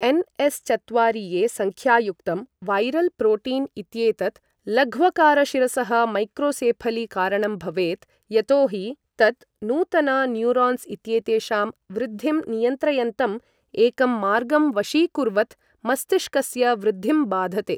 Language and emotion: Sanskrit, neutral